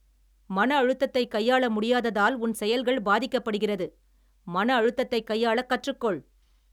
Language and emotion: Tamil, angry